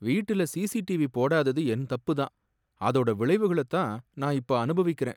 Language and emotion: Tamil, sad